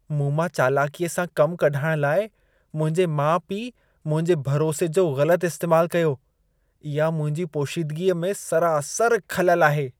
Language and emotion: Sindhi, disgusted